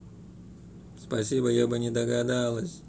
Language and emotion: Russian, angry